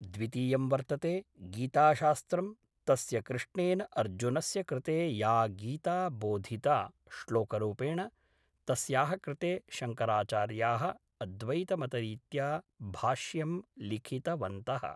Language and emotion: Sanskrit, neutral